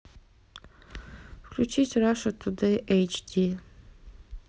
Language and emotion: Russian, neutral